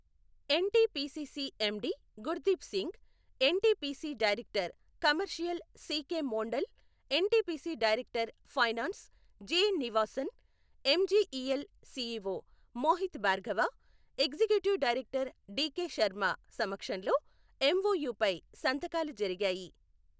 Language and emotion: Telugu, neutral